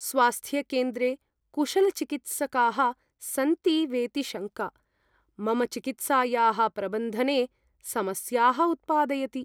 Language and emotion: Sanskrit, fearful